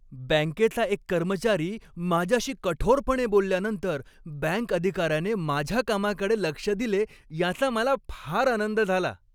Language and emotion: Marathi, happy